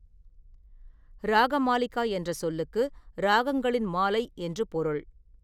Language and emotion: Tamil, neutral